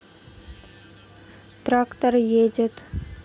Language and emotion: Russian, neutral